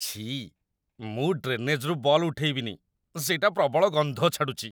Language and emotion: Odia, disgusted